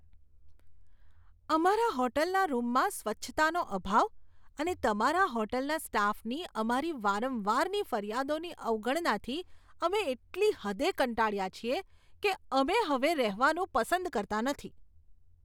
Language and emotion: Gujarati, disgusted